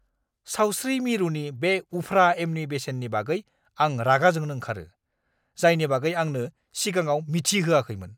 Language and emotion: Bodo, angry